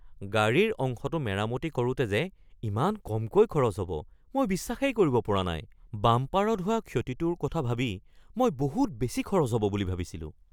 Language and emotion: Assamese, surprised